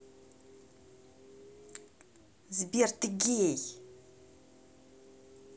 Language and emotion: Russian, angry